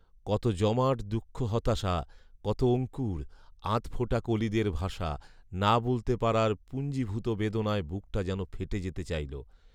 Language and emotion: Bengali, neutral